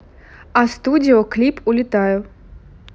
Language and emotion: Russian, neutral